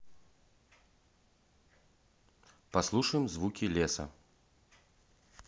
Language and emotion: Russian, neutral